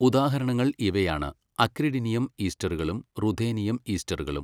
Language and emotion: Malayalam, neutral